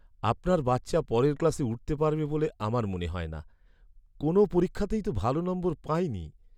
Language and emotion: Bengali, sad